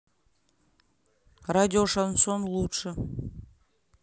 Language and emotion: Russian, neutral